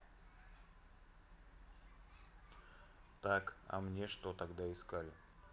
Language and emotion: Russian, neutral